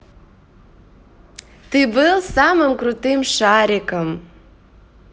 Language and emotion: Russian, positive